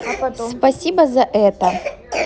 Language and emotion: Russian, neutral